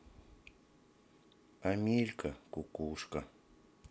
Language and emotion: Russian, sad